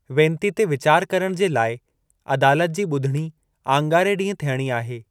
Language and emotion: Sindhi, neutral